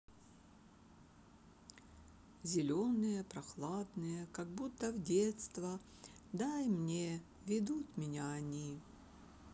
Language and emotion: Russian, neutral